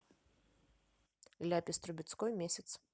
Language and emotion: Russian, neutral